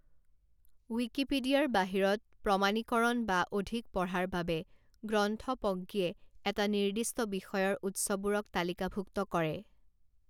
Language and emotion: Assamese, neutral